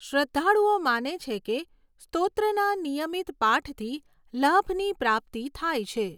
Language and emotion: Gujarati, neutral